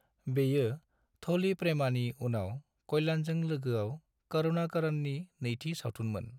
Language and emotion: Bodo, neutral